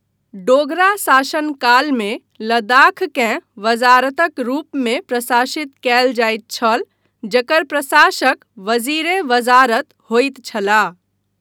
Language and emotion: Maithili, neutral